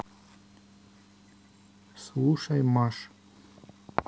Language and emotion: Russian, neutral